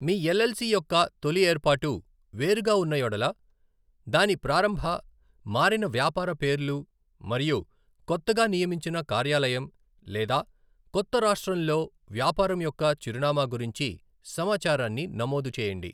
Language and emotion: Telugu, neutral